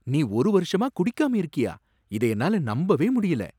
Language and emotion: Tamil, surprised